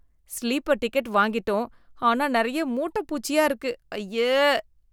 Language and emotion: Tamil, disgusted